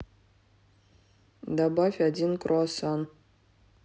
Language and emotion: Russian, neutral